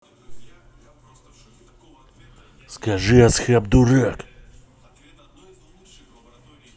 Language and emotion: Russian, angry